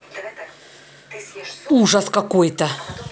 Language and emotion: Russian, angry